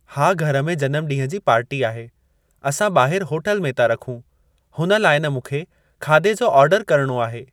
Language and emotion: Sindhi, neutral